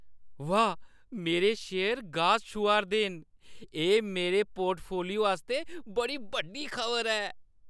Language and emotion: Dogri, happy